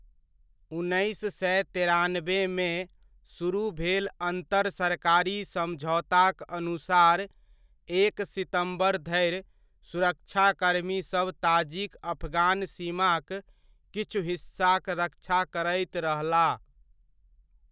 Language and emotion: Maithili, neutral